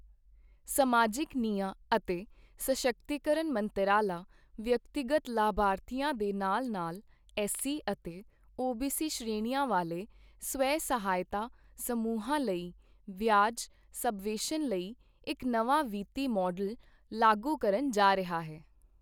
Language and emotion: Punjabi, neutral